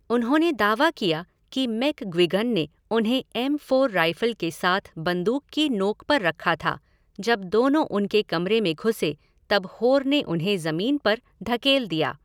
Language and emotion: Hindi, neutral